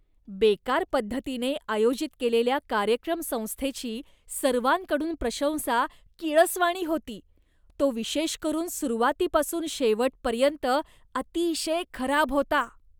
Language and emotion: Marathi, disgusted